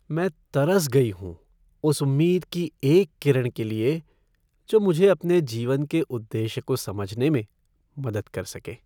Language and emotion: Hindi, sad